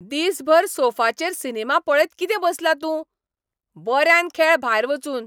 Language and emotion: Goan Konkani, angry